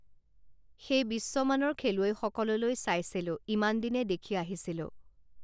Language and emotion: Assamese, neutral